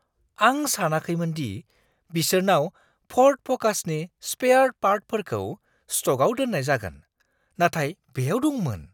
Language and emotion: Bodo, surprised